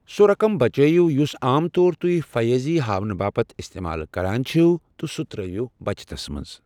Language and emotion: Kashmiri, neutral